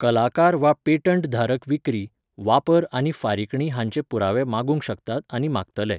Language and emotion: Goan Konkani, neutral